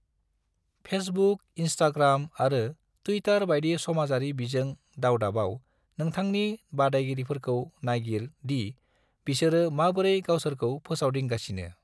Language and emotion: Bodo, neutral